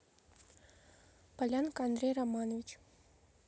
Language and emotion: Russian, neutral